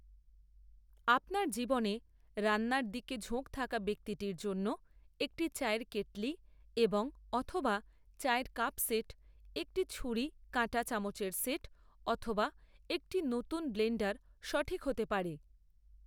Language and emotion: Bengali, neutral